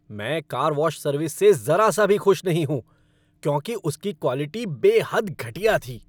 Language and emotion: Hindi, angry